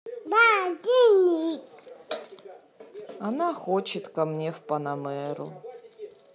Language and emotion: Russian, neutral